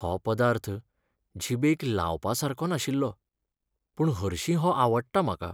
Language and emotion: Goan Konkani, sad